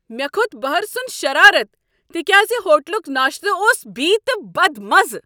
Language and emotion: Kashmiri, angry